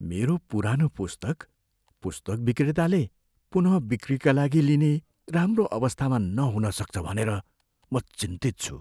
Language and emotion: Nepali, fearful